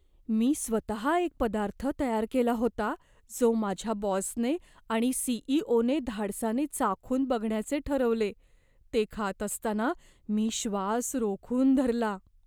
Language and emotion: Marathi, fearful